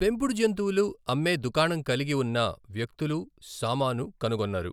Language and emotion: Telugu, neutral